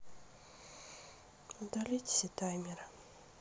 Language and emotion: Russian, sad